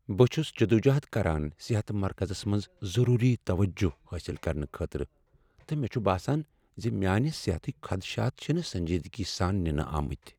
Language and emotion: Kashmiri, sad